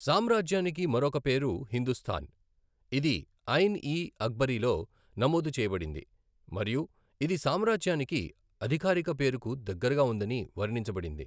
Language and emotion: Telugu, neutral